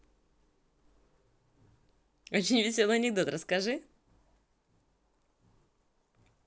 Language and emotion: Russian, positive